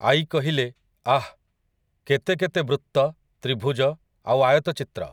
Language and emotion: Odia, neutral